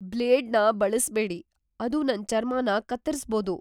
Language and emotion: Kannada, fearful